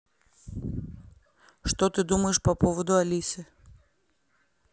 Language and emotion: Russian, neutral